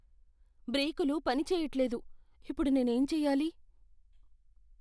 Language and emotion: Telugu, fearful